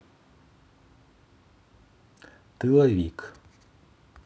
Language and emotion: Russian, neutral